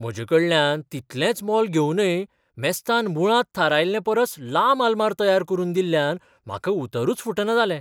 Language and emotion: Goan Konkani, surprised